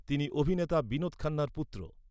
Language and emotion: Bengali, neutral